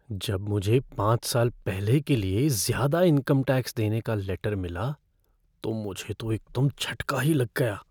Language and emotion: Hindi, fearful